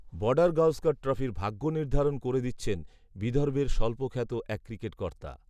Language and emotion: Bengali, neutral